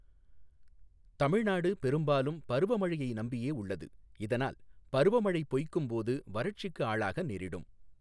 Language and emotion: Tamil, neutral